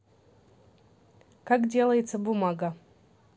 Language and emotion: Russian, neutral